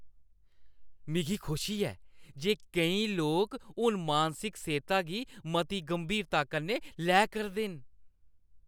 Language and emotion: Dogri, happy